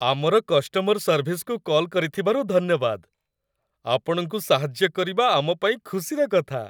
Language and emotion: Odia, happy